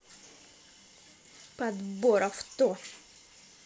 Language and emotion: Russian, angry